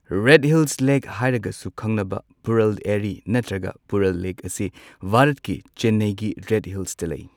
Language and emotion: Manipuri, neutral